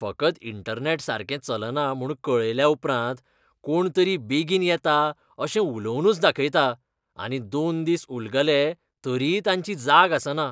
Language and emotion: Goan Konkani, disgusted